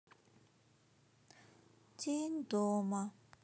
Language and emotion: Russian, sad